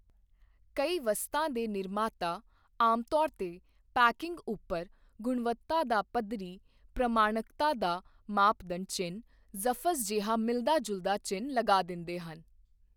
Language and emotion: Punjabi, neutral